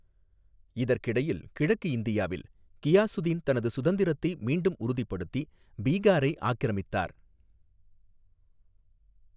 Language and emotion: Tamil, neutral